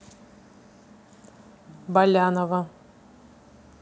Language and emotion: Russian, neutral